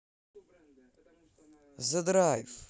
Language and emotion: Russian, positive